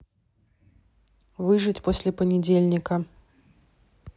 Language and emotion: Russian, neutral